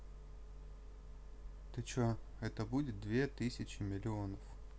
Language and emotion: Russian, neutral